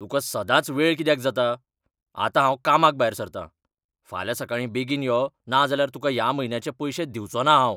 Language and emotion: Goan Konkani, angry